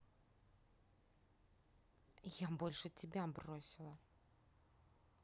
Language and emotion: Russian, angry